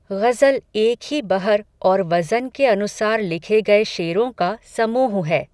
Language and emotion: Hindi, neutral